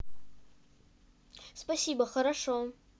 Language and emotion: Russian, neutral